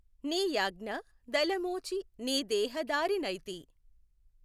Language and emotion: Telugu, neutral